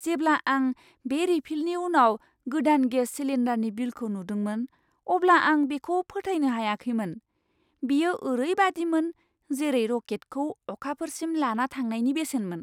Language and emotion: Bodo, surprised